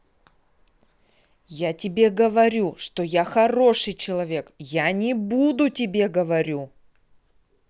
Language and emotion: Russian, angry